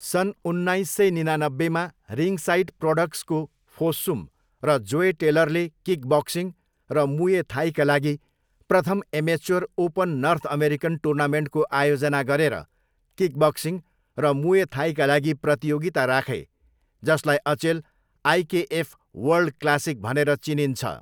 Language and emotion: Nepali, neutral